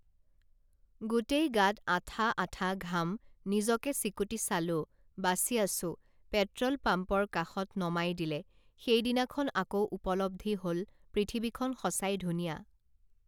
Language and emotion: Assamese, neutral